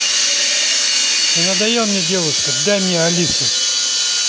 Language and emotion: Russian, angry